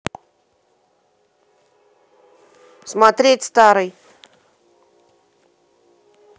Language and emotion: Russian, neutral